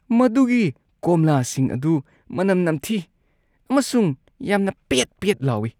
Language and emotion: Manipuri, disgusted